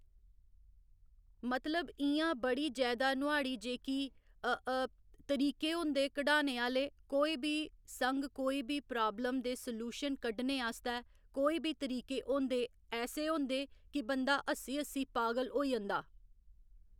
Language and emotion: Dogri, neutral